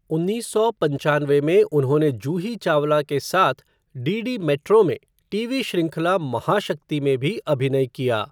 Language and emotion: Hindi, neutral